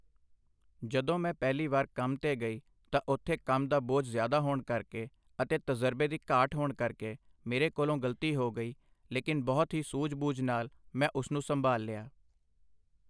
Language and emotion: Punjabi, neutral